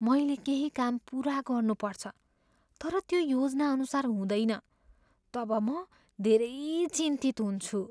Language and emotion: Nepali, fearful